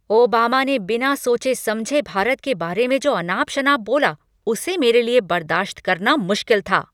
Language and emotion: Hindi, angry